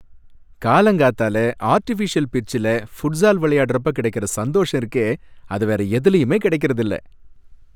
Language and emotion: Tamil, happy